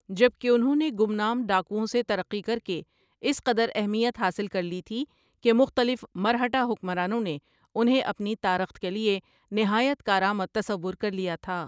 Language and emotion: Urdu, neutral